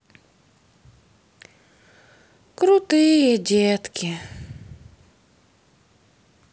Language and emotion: Russian, sad